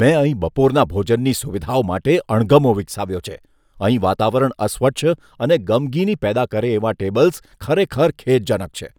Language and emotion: Gujarati, disgusted